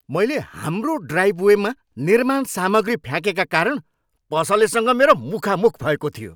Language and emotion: Nepali, angry